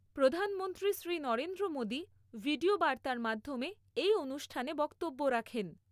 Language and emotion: Bengali, neutral